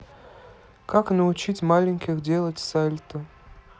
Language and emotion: Russian, neutral